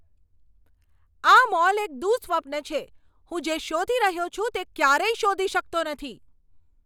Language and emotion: Gujarati, angry